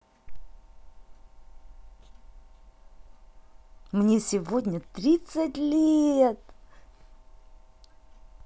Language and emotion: Russian, positive